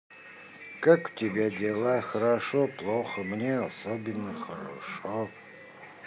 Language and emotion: Russian, neutral